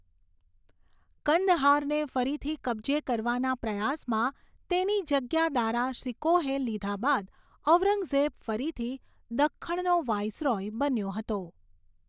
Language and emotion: Gujarati, neutral